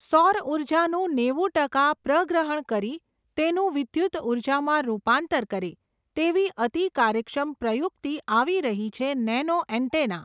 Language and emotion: Gujarati, neutral